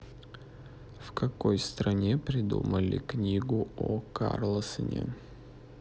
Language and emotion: Russian, neutral